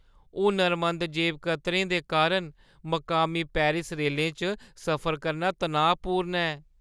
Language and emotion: Dogri, fearful